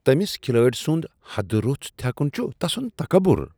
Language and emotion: Kashmiri, disgusted